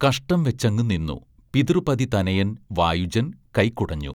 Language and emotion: Malayalam, neutral